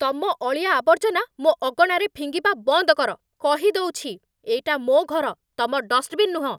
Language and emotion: Odia, angry